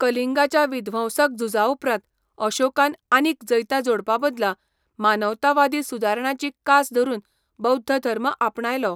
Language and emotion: Goan Konkani, neutral